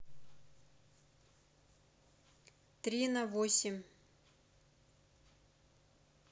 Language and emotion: Russian, neutral